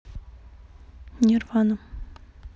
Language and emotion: Russian, neutral